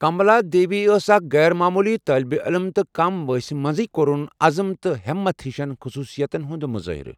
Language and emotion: Kashmiri, neutral